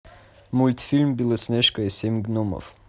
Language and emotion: Russian, neutral